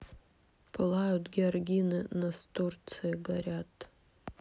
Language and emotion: Russian, sad